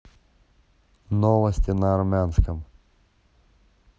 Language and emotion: Russian, neutral